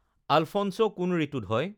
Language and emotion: Assamese, neutral